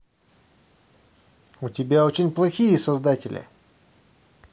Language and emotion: Russian, angry